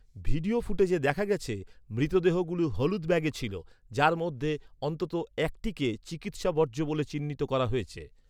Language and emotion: Bengali, neutral